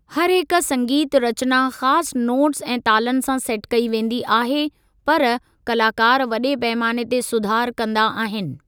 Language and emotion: Sindhi, neutral